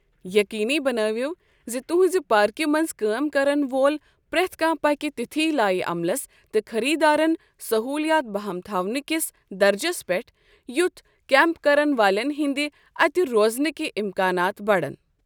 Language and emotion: Kashmiri, neutral